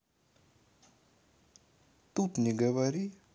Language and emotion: Russian, neutral